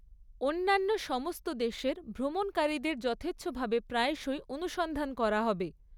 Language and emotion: Bengali, neutral